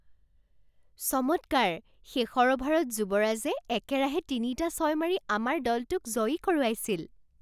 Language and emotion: Assamese, surprised